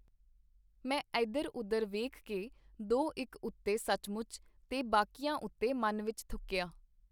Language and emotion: Punjabi, neutral